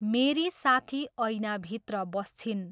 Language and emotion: Nepali, neutral